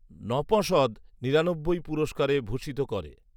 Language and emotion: Bengali, neutral